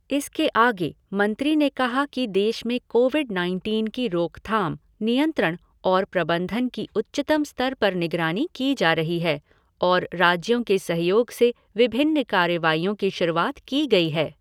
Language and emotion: Hindi, neutral